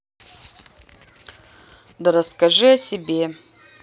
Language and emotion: Russian, neutral